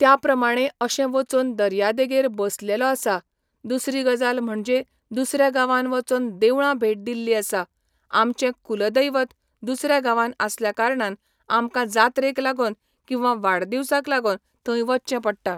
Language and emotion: Goan Konkani, neutral